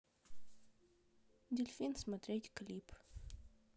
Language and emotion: Russian, neutral